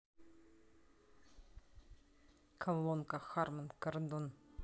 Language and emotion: Russian, neutral